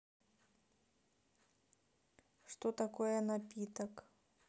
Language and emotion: Russian, neutral